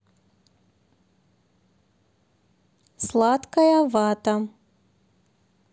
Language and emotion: Russian, neutral